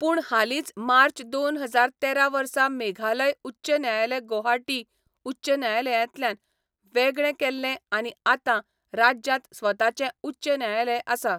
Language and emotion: Goan Konkani, neutral